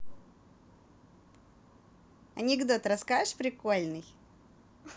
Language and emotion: Russian, positive